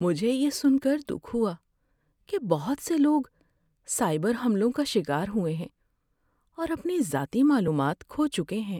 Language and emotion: Urdu, sad